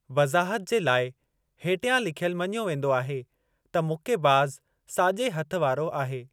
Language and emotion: Sindhi, neutral